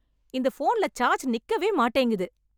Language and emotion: Tamil, angry